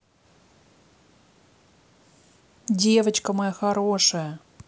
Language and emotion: Russian, positive